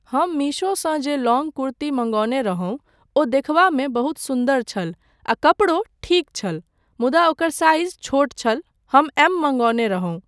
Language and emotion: Maithili, neutral